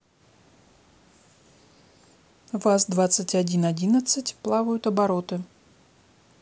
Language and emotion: Russian, neutral